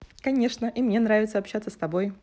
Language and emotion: Russian, positive